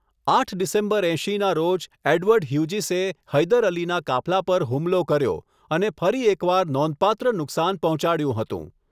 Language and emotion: Gujarati, neutral